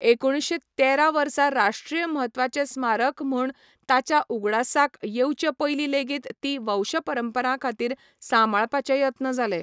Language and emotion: Goan Konkani, neutral